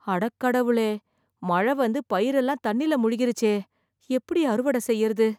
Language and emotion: Tamil, fearful